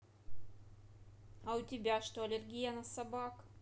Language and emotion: Russian, neutral